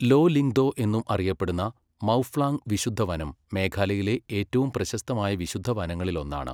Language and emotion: Malayalam, neutral